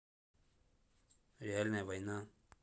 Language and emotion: Russian, neutral